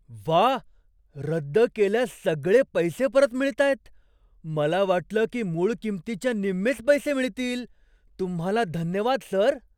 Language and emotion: Marathi, surprised